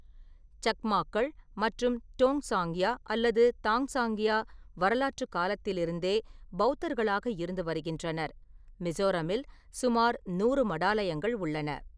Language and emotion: Tamil, neutral